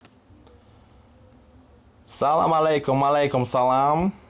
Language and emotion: Russian, positive